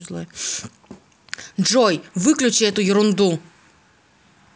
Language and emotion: Russian, angry